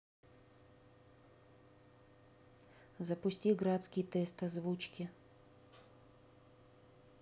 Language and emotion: Russian, neutral